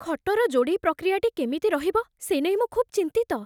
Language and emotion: Odia, fearful